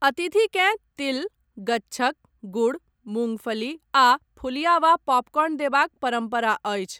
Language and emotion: Maithili, neutral